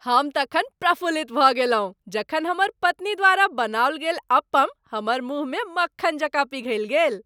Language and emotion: Maithili, happy